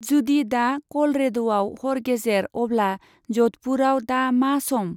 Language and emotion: Bodo, neutral